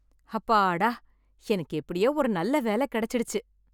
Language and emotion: Tamil, happy